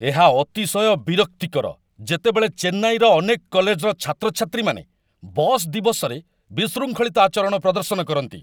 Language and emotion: Odia, angry